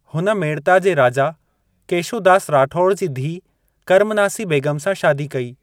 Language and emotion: Sindhi, neutral